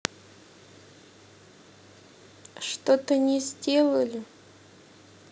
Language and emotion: Russian, sad